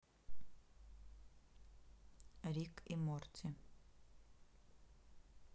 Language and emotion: Russian, neutral